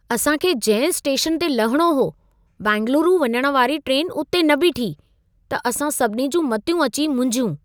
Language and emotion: Sindhi, surprised